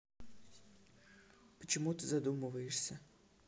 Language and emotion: Russian, neutral